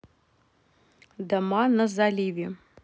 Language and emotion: Russian, neutral